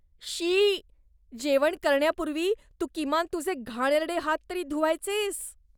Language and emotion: Marathi, disgusted